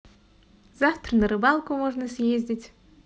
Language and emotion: Russian, positive